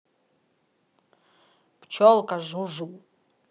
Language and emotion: Russian, neutral